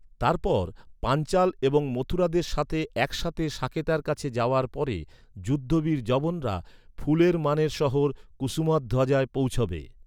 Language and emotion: Bengali, neutral